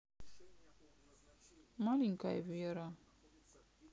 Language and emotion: Russian, sad